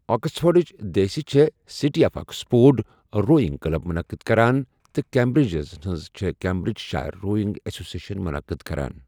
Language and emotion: Kashmiri, neutral